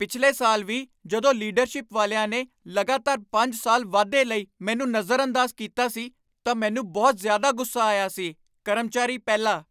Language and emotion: Punjabi, angry